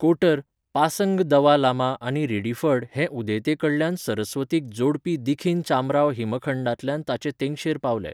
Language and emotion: Goan Konkani, neutral